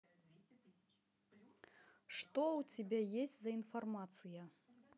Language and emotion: Russian, neutral